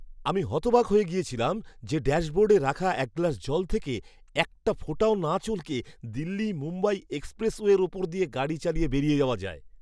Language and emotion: Bengali, surprised